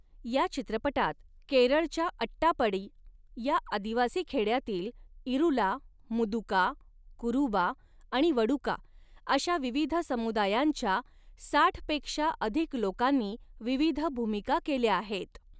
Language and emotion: Marathi, neutral